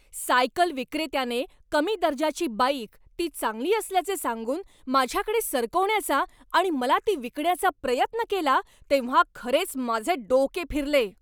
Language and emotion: Marathi, angry